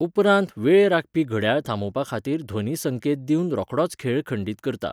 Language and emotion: Goan Konkani, neutral